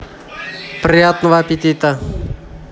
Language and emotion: Russian, positive